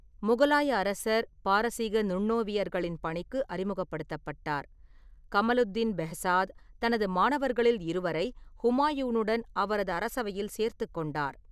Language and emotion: Tamil, neutral